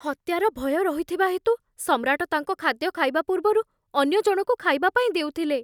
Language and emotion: Odia, fearful